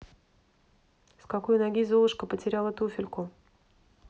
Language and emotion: Russian, neutral